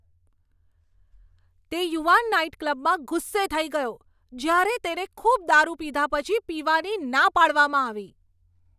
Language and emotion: Gujarati, angry